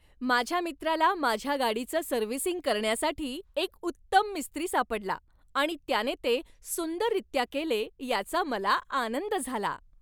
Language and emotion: Marathi, happy